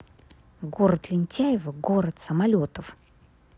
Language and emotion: Russian, angry